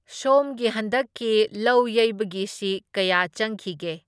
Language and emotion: Manipuri, neutral